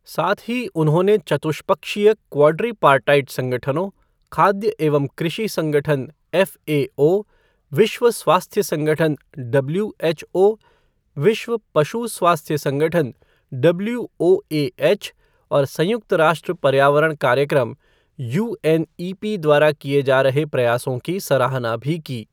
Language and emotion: Hindi, neutral